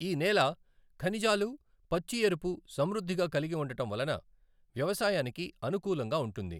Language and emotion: Telugu, neutral